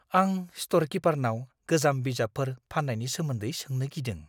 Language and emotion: Bodo, fearful